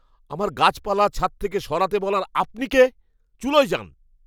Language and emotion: Bengali, angry